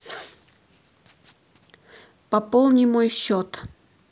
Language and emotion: Russian, neutral